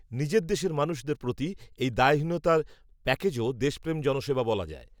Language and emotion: Bengali, neutral